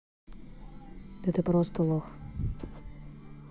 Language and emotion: Russian, neutral